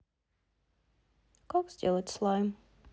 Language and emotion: Russian, sad